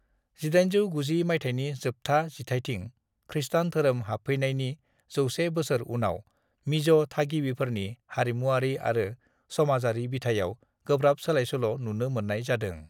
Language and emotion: Bodo, neutral